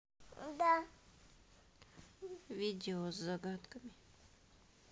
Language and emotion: Russian, neutral